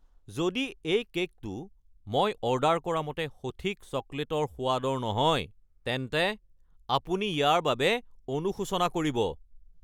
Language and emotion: Assamese, angry